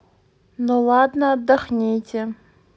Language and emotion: Russian, neutral